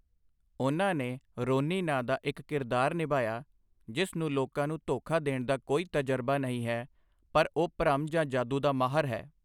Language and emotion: Punjabi, neutral